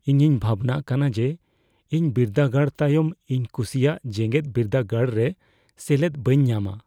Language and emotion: Santali, fearful